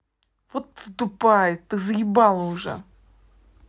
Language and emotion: Russian, angry